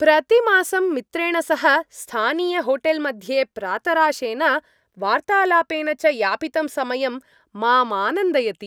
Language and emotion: Sanskrit, happy